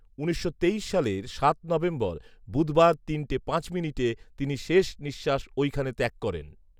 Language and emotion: Bengali, neutral